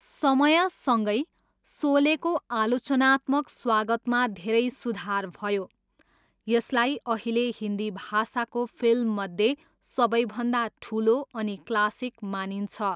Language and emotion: Nepali, neutral